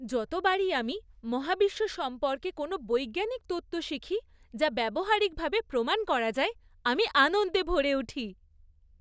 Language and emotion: Bengali, happy